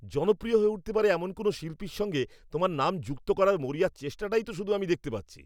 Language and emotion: Bengali, angry